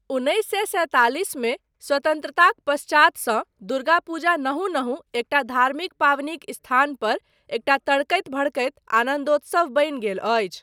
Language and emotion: Maithili, neutral